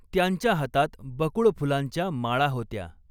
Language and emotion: Marathi, neutral